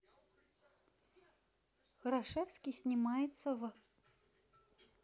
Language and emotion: Russian, neutral